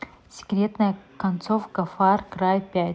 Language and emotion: Russian, neutral